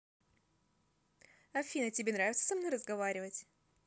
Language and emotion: Russian, positive